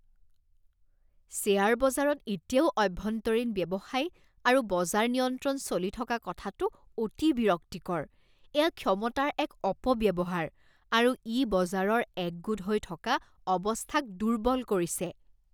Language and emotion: Assamese, disgusted